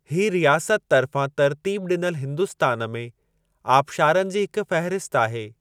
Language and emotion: Sindhi, neutral